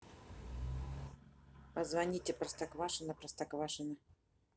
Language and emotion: Russian, neutral